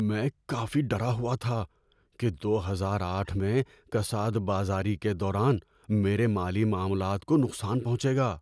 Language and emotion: Urdu, fearful